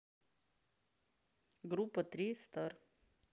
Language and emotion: Russian, neutral